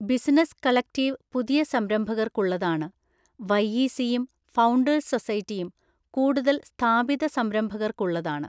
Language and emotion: Malayalam, neutral